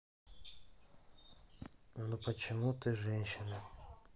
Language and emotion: Russian, sad